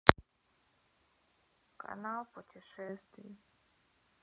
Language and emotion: Russian, sad